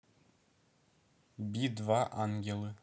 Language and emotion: Russian, neutral